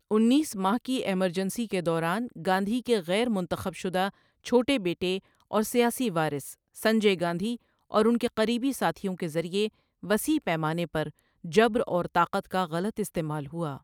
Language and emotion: Urdu, neutral